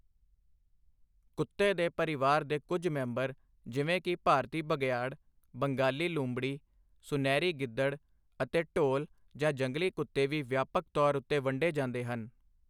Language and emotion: Punjabi, neutral